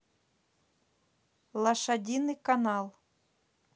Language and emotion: Russian, neutral